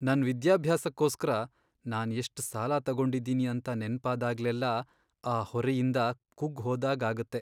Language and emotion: Kannada, sad